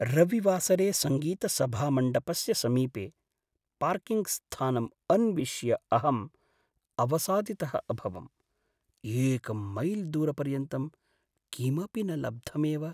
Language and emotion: Sanskrit, sad